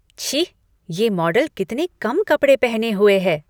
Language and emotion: Hindi, disgusted